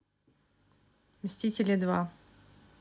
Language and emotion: Russian, neutral